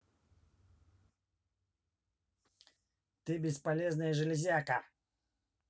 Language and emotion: Russian, angry